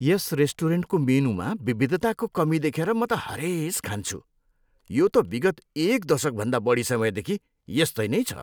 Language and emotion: Nepali, disgusted